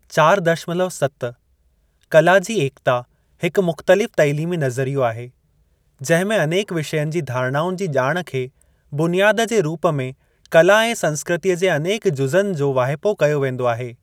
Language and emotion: Sindhi, neutral